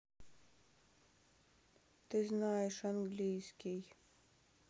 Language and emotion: Russian, sad